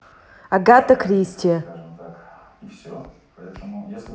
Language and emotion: Russian, neutral